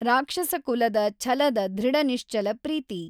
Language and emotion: Kannada, neutral